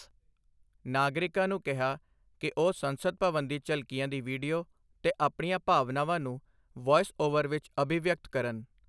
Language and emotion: Punjabi, neutral